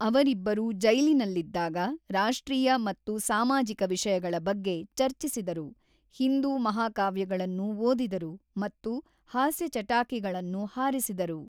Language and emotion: Kannada, neutral